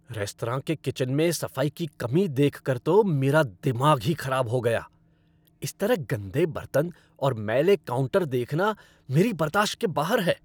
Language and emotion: Hindi, angry